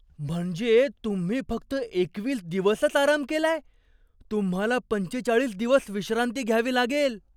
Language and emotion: Marathi, surprised